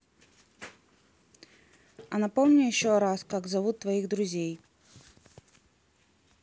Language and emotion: Russian, neutral